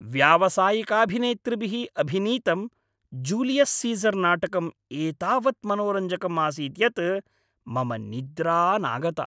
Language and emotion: Sanskrit, happy